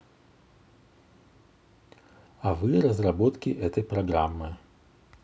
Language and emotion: Russian, neutral